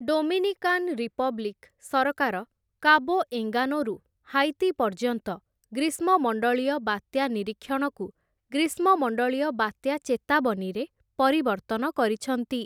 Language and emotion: Odia, neutral